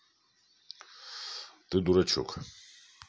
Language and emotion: Russian, neutral